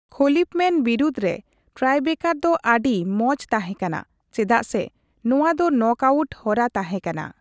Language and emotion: Santali, neutral